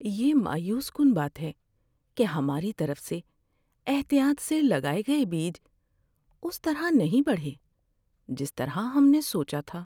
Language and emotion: Urdu, sad